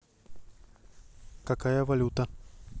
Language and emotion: Russian, neutral